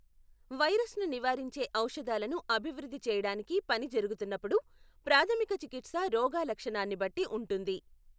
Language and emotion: Telugu, neutral